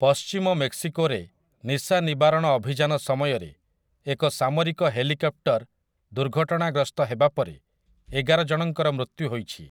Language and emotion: Odia, neutral